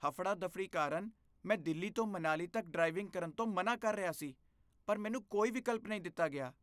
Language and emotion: Punjabi, disgusted